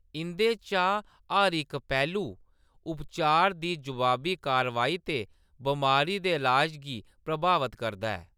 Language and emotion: Dogri, neutral